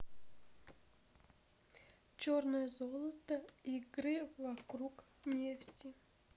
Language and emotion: Russian, sad